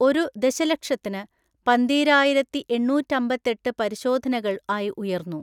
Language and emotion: Malayalam, neutral